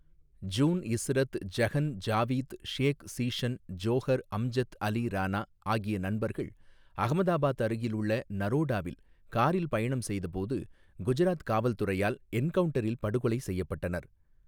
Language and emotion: Tamil, neutral